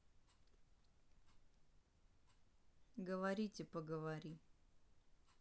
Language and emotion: Russian, neutral